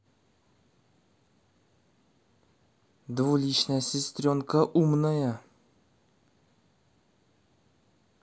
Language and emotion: Russian, neutral